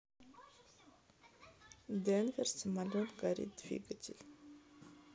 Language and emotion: Russian, neutral